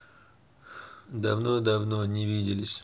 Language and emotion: Russian, neutral